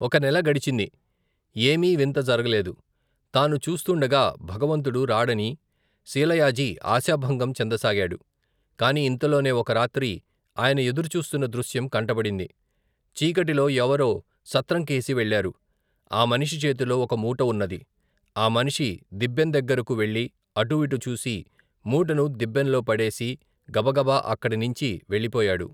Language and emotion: Telugu, neutral